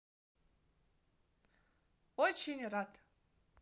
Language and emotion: Russian, positive